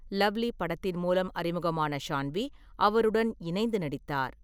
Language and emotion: Tamil, neutral